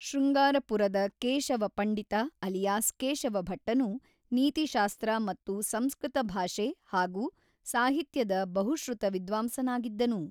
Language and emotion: Kannada, neutral